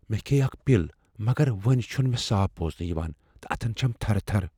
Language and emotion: Kashmiri, fearful